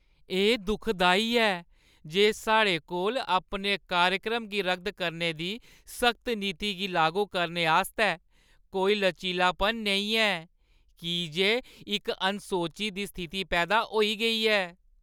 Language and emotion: Dogri, sad